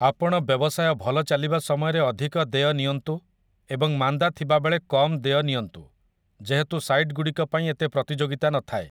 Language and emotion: Odia, neutral